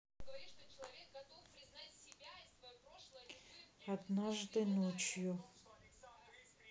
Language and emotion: Russian, sad